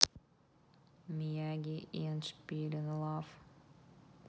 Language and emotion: Russian, neutral